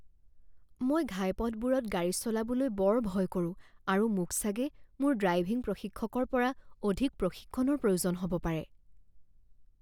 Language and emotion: Assamese, fearful